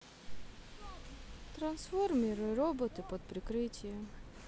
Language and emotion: Russian, sad